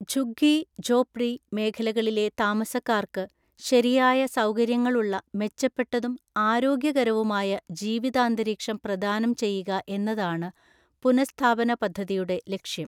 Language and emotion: Malayalam, neutral